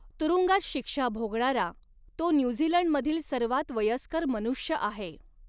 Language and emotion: Marathi, neutral